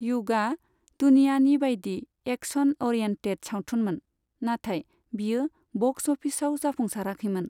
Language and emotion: Bodo, neutral